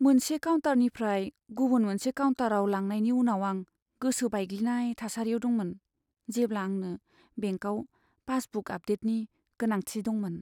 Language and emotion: Bodo, sad